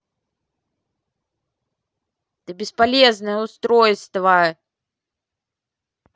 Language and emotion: Russian, angry